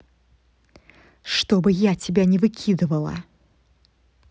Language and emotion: Russian, angry